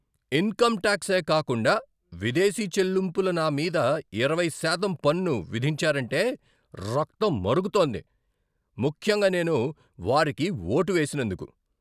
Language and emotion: Telugu, angry